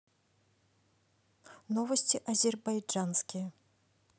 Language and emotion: Russian, neutral